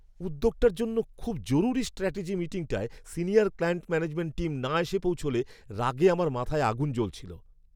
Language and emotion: Bengali, angry